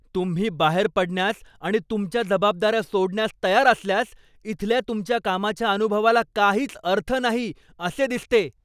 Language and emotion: Marathi, angry